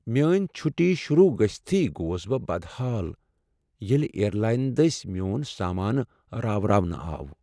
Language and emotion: Kashmiri, sad